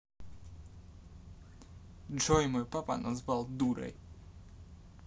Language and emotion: Russian, angry